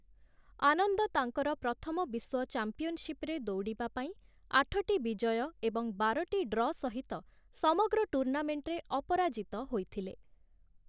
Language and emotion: Odia, neutral